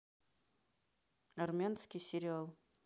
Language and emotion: Russian, neutral